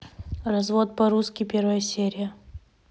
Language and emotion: Russian, neutral